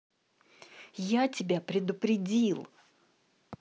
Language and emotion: Russian, angry